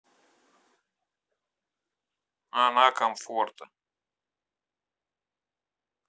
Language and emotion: Russian, neutral